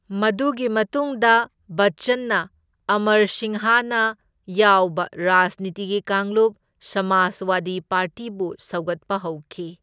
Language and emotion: Manipuri, neutral